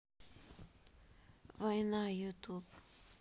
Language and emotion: Russian, sad